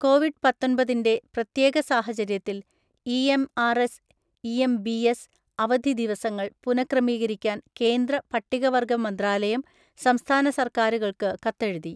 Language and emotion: Malayalam, neutral